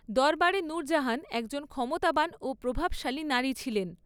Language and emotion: Bengali, neutral